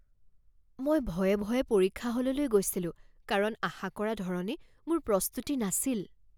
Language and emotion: Assamese, fearful